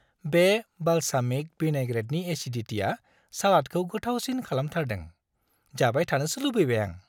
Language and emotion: Bodo, happy